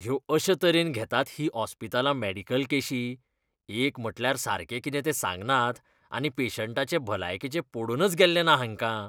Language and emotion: Goan Konkani, disgusted